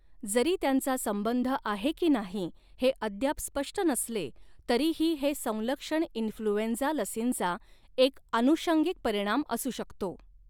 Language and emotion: Marathi, neutral